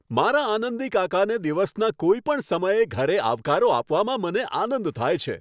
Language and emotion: Gujarati, happy